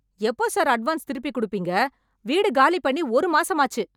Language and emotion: Tamil, angry